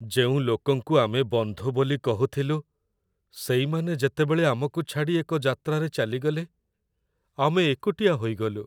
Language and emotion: Odia, sad